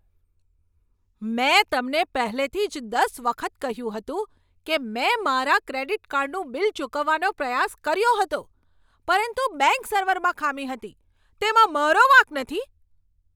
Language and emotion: Gujarati, angry